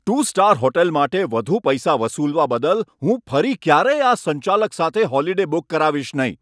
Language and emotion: Gujarati, angry